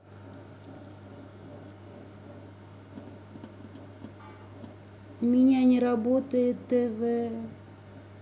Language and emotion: Russian, sad